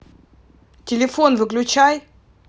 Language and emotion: Russian, angry